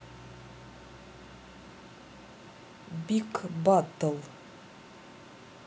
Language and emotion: Russian, neutral